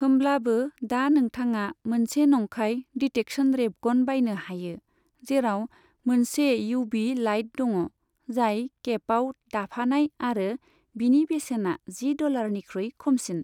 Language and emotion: Bodo, neutral